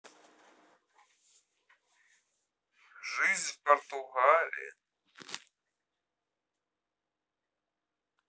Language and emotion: Russian, neutral